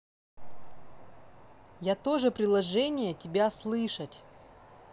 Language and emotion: Russian, neutral